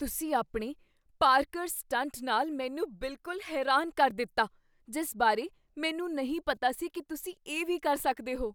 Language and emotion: Punjabi, surprised